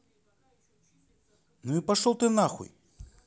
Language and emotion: Russian, angry